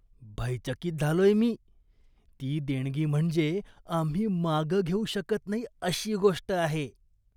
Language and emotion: Marathi, disgusted